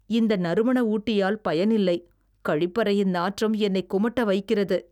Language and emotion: Tamil, disgusted